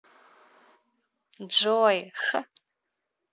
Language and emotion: Russian, positive